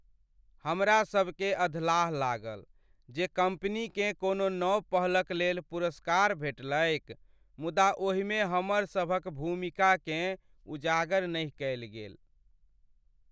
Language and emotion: Maithili, sad